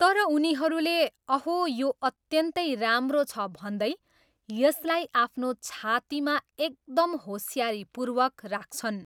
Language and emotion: Nepali, neutral